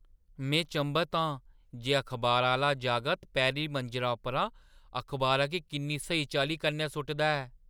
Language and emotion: Dogri, surprised